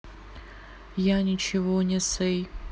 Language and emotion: Russian, sad